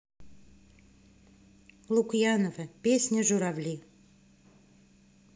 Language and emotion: Russian, neutral